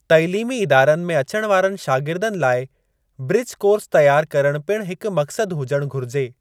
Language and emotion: Sindhi, neutral